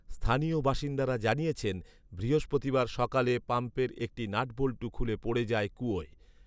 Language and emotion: Bengali, neutral